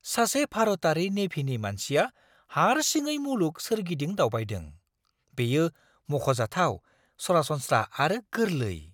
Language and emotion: Bodo, surprised